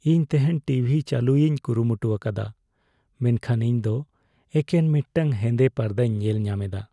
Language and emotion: Santali, sad